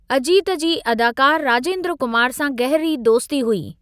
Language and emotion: Sindhi, neutral